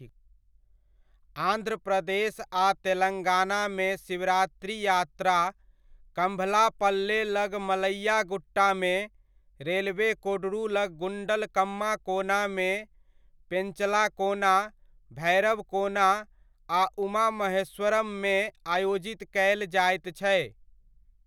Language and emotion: Maithili, neutral